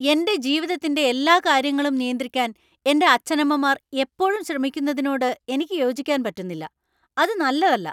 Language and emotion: Malayalam, angry